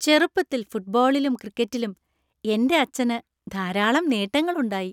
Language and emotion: Malayalam, happy